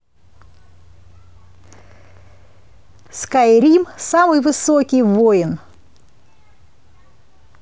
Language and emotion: Russian, positive